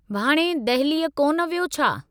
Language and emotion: Sindhi, neutral